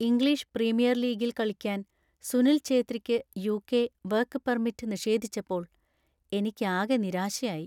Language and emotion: Malayalam, sad